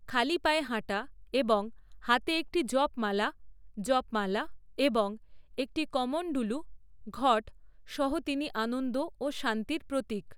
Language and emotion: Bengali, neutral